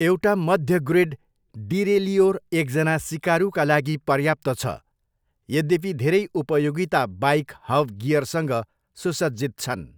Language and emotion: Nepali, neutral